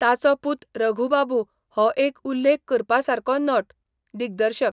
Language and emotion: Goan Konkani, neutral